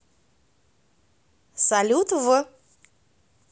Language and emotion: Russian, neutral